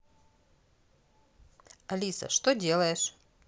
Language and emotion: Russian, neutral